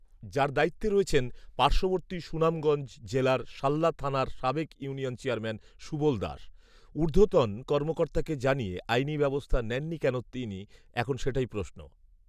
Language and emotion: Bengali, neutral